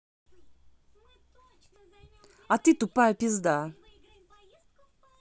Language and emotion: Russian, angry